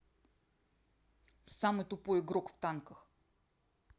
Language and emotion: Russian, neutral